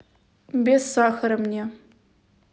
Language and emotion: Russian, neutral